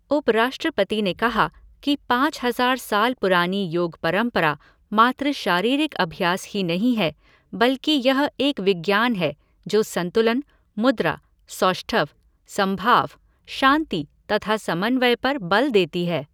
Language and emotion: Hindi, neutral